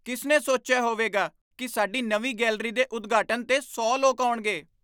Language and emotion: Punjabi, surprised